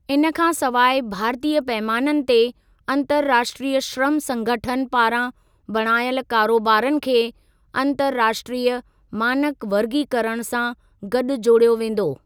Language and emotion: Sindhi, neutral